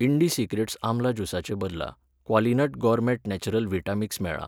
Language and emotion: Goan Konkani, neutral